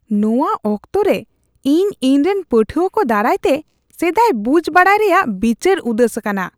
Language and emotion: Santali, disgusted